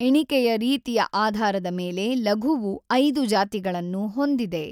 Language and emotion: Kannada, neutral